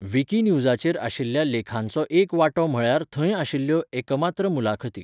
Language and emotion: Goan Konkani, neutral